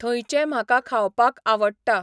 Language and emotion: Goan Konkani, neutral